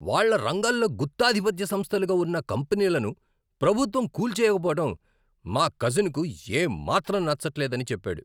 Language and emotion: Telugu, angry